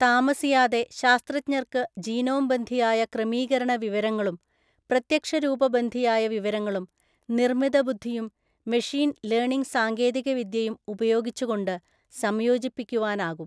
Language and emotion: Malayalam, neutral